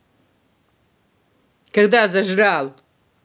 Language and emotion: Russian, angry